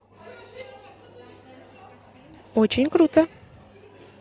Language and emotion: Russian, positive